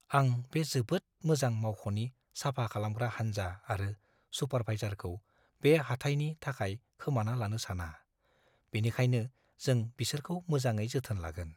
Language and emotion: Bodo, fearful